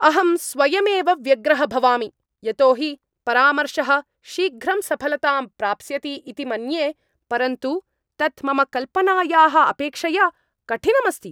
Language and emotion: Sanskrit, angry